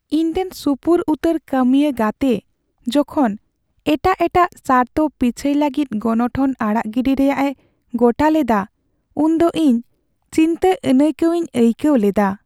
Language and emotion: Santali, sad